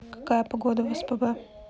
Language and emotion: Russian, neutral